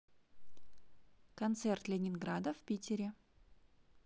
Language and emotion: Russian, neutral